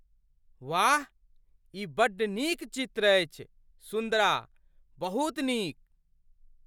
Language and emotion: Maithili, surprised